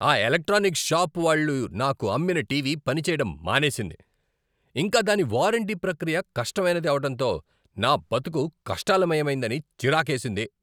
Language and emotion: Telugu, angry